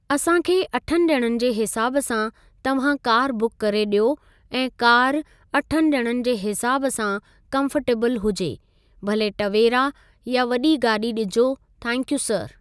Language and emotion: Sindhi, neutral